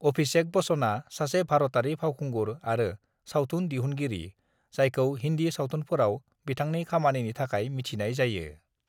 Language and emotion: Bodo, neutral